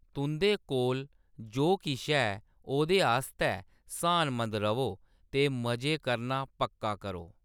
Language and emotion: Dogri, neutral